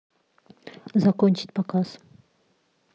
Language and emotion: Russian, neutral